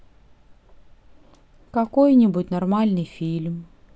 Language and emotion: Russian, sad